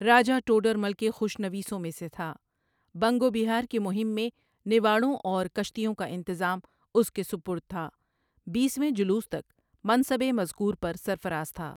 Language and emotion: Urdu, neutral